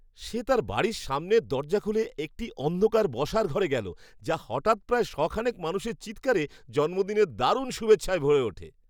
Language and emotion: Bengali, surprised